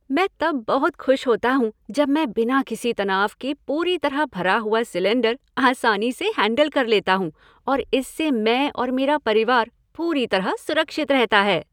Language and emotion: Hindi, happy